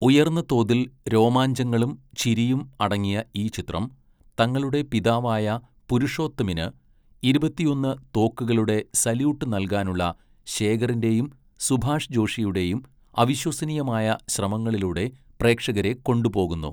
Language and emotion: Malayalam, neutral